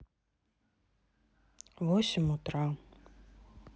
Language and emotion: Russian, sad